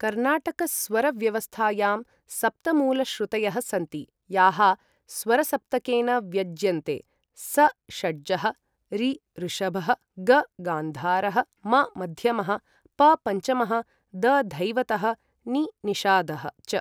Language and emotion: Sanskrit, neutral